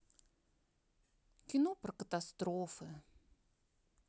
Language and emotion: Russian, sad